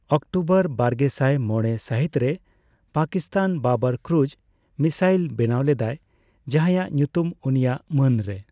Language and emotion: Santali, neutral